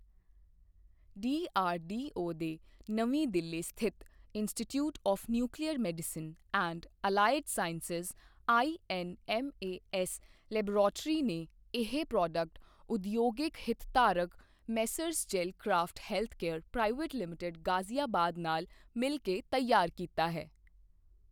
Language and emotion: Punjabi, neutral